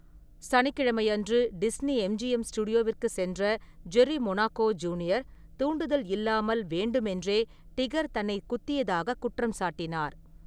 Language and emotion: Tamil, neutral